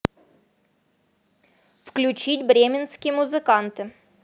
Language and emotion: Russian, neutral